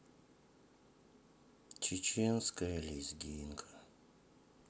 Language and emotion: Russian, sad